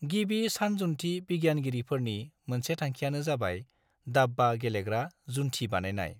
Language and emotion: Bodo, neutral